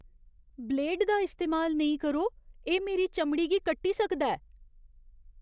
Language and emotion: Dogri, fearful